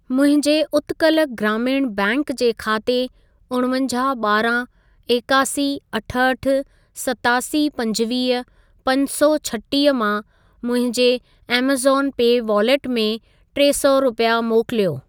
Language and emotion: Sindhi, neutral